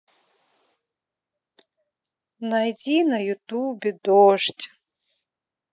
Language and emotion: Russian, sad